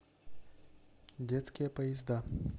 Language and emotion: Russian, neutral